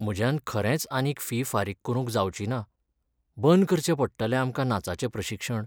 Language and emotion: Goan Konkani, sad